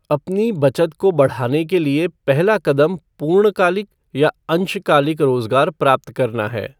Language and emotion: Hindi, neutral